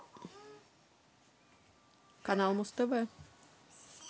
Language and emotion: Russian, neutral